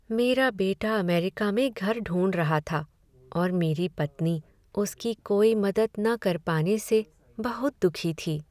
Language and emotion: Hindi, sad